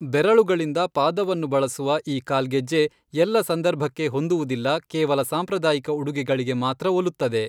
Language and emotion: Kannada, neutral